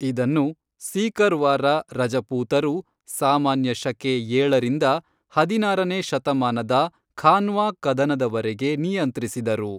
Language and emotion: Kannada, neutral